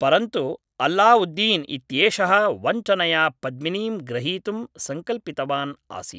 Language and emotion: Sanskrit, neutral